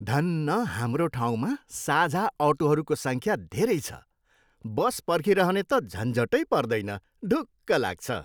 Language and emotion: Nepali, happy